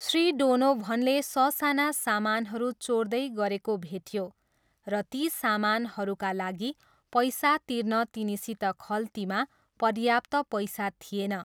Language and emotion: Nepali, neutral